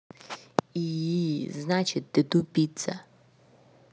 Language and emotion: Russian, angry